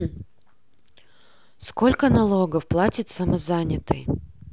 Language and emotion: Russian, neutral